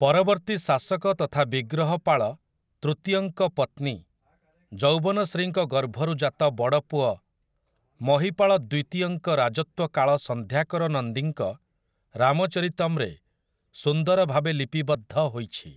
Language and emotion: Odia, neutral